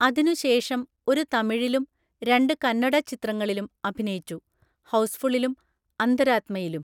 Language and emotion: Malayalam, neutral